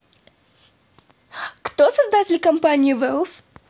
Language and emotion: Russian, positive